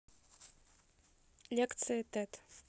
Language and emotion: Russian, neutral